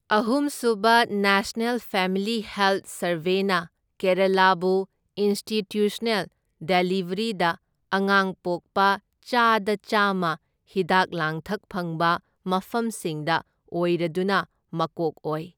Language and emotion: Manipuri, neutral